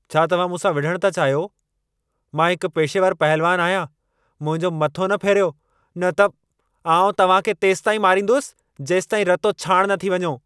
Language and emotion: Sindhi, angry